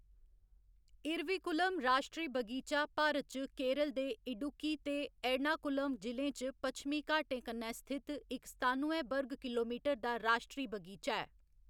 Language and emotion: Dogri, neutral